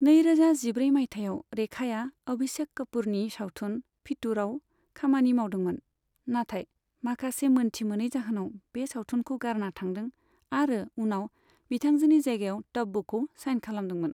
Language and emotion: Bodo, neutral